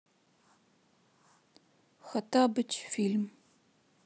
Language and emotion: Russian, sad